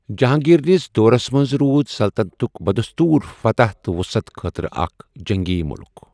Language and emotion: Kashmiri, neutral